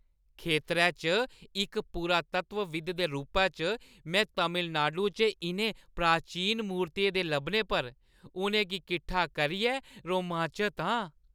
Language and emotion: Dogri, happy